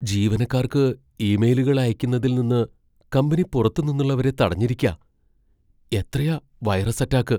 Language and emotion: Malayalam, fearful